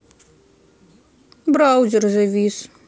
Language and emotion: Russian, sad